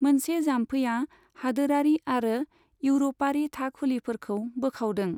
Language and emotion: Bodo, neutral